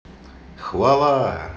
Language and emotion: Russian, positive